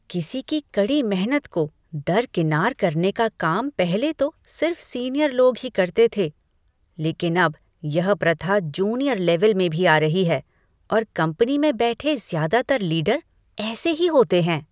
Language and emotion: Hindi, disgusted